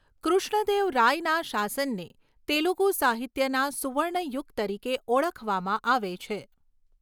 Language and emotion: Gujarati, neutral